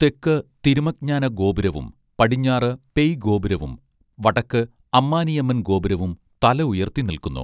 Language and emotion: Malayalam, neutral